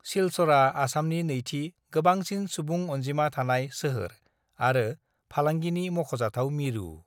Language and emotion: Bodo, neutral